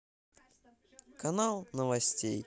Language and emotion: Russian, positive